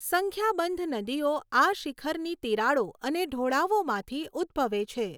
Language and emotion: Gujarati, neutral